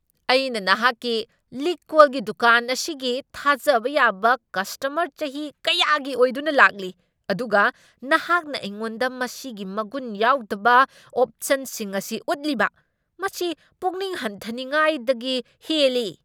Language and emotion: Manipuri, angry